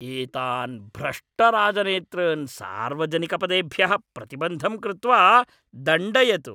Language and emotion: Sanskrit, angry